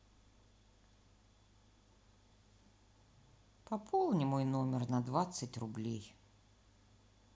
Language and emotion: Russian, sad